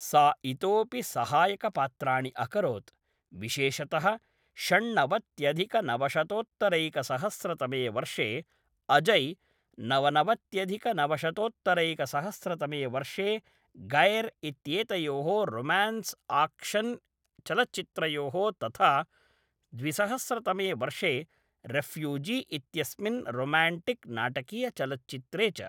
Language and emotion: Sanskrit, neutral